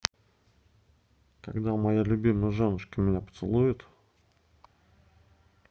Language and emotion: Russian, neutral